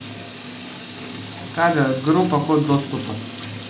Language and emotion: Russian, neutral